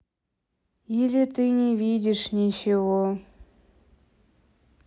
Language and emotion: Russian, sad